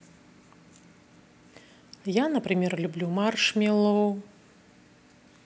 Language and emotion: Russian, neutral